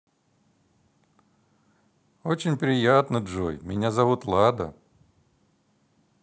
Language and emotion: Russian, positive